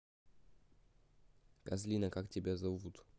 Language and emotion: Russian, neutral